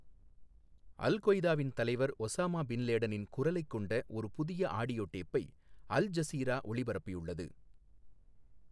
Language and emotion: Tamil, neutral